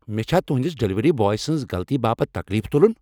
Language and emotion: Kashmiri, angry